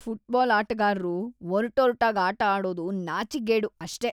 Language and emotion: Kannada, disgusted